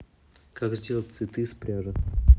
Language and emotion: Russian, neutral